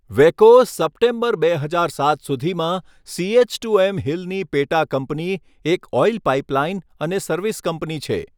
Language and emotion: Gujarati, neutral